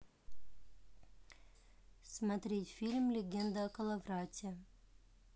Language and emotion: Russian, neutral